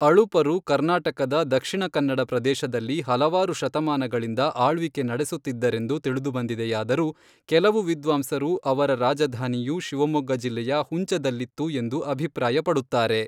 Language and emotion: Kannada, neutral